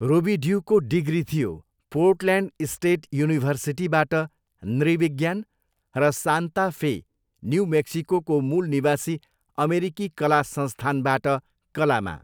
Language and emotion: Nepali, neutral